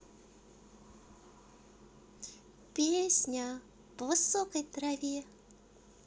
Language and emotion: Russian, positive